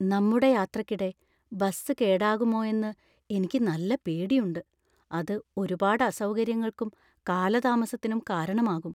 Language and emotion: Malayalam, fearful